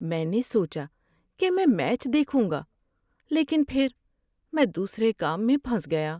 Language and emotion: Urdu, sad